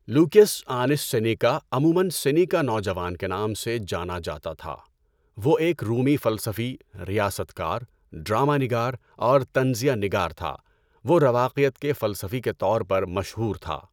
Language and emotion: Urdu, neutral